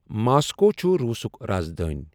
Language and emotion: Kashmiri, neutral